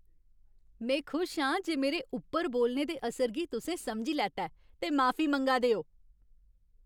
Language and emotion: Dogri, happy